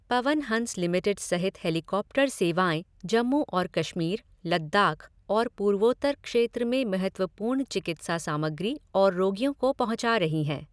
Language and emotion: Hindi, neutral